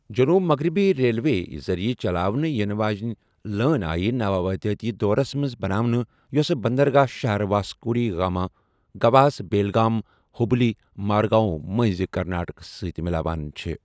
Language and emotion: Kashmiri, neutral